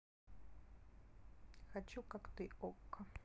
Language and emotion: Russian, neutral